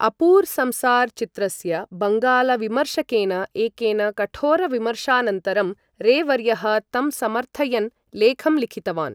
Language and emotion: Sanskrit, neutral